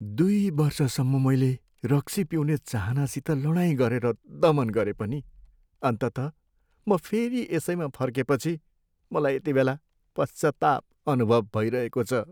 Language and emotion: Nepali, sad